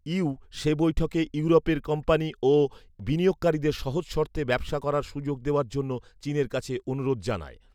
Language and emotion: Bengali, neutral